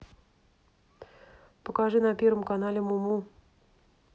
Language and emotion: Russian, neutral